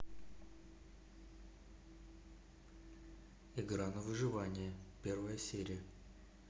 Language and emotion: Russian, neutral